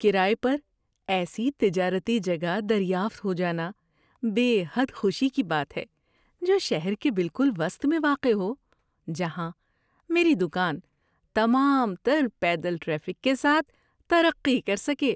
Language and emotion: Urdu, happy